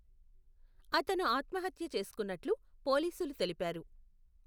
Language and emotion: Telugu, neutral